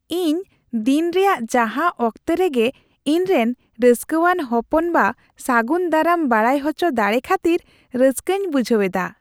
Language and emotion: Santali, happy